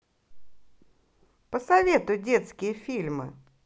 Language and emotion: Russian, positive